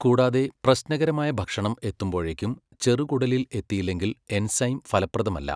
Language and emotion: Malayalam, neutral